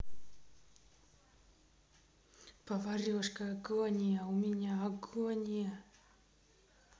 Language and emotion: Russian, neutral